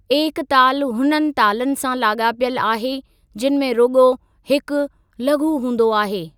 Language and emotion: Sindhi, neutral